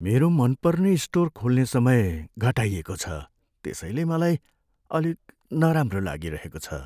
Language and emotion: Nepali, sad